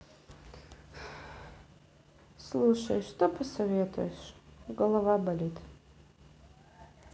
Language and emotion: Russian, sad